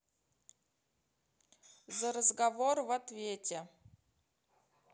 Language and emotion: Russian, neutral